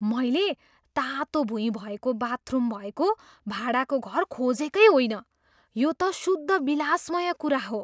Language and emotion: Nepali, surprised